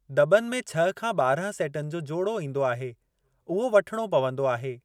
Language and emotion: Sindhi, neutral